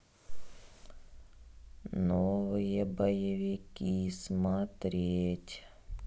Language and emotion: Russian, neutral